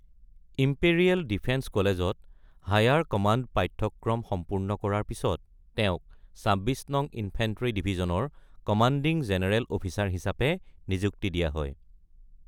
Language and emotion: Assamese, neutral